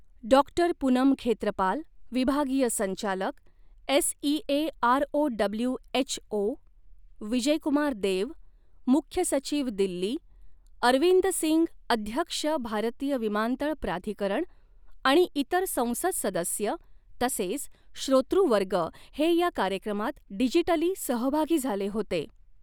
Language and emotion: Marathi, neutral